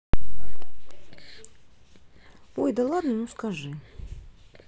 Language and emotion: Russian, neutral